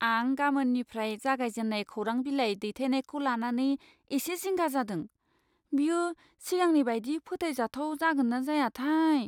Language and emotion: Bodo, fearful